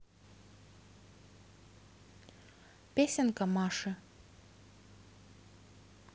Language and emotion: Russian, neutral